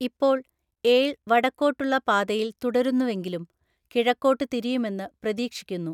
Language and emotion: Malayalam, neutral